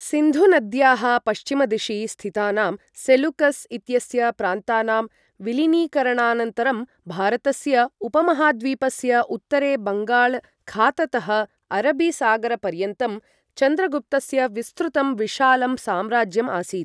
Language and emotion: Sanskrit, neutral